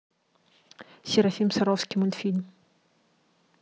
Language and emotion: Russian, neutral